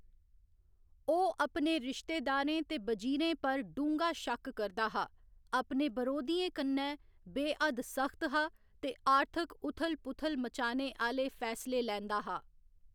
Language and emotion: Dogri, neutral